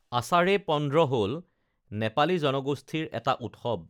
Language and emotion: Assamese, neutral